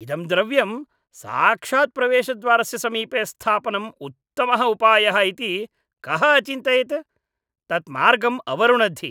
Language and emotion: Sanskrit, disgusted